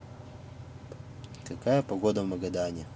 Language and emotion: Russian, neutral